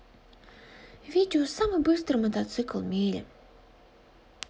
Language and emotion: Russian, sad